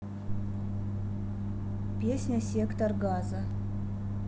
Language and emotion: Russian, neutral